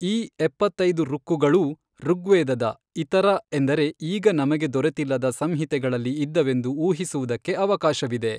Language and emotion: Kannada, neutral